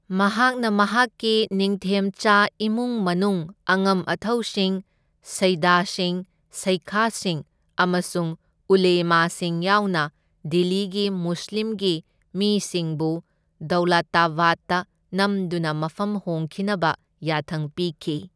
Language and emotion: Manipuri, neutral